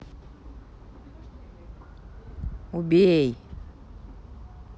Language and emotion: Russian, angry